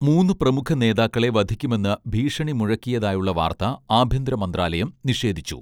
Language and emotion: Malayalam, neutral